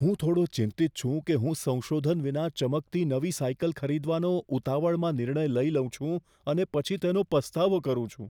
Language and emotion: Gujarati, fearful